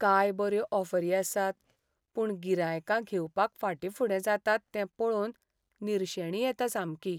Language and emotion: Goan Konkani, sad